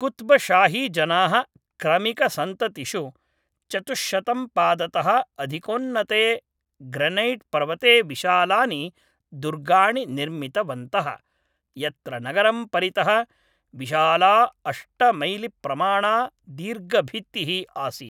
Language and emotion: Sanskrit, neutral